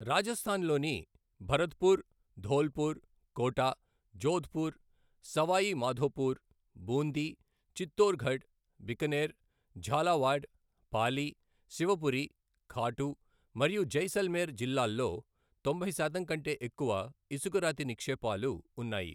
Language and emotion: Telugu, neutral